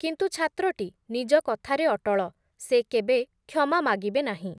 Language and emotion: Odia, neutral